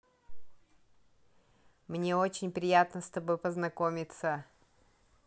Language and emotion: Russian, positive